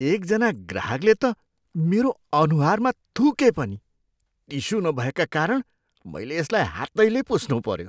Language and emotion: Nepali, disgusted